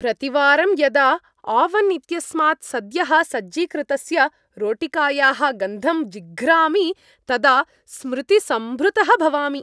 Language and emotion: Sanskrit, happy